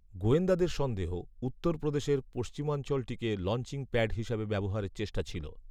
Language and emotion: Bengali, neutral